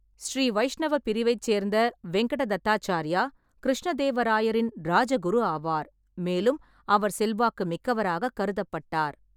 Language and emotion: Tamil, neutral